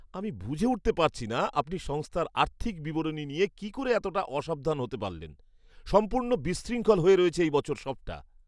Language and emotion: Bengali, angry